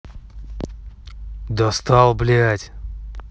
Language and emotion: Russian, angry